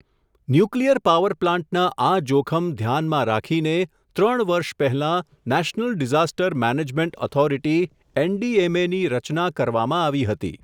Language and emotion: Gujarati, neutral